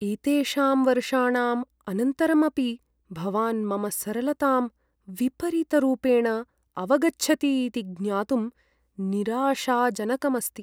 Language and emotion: Sanskrit, sad